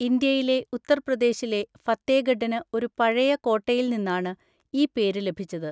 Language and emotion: Malayalam, neutral